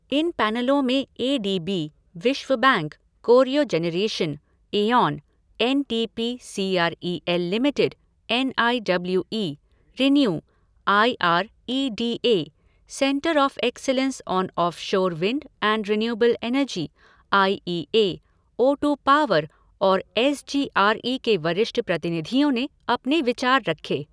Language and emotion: Hindi, neutral